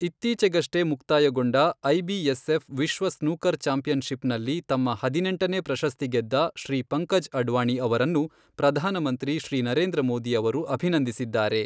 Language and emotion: Kannada, neutral